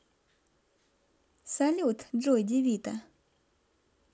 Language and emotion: Russian, positive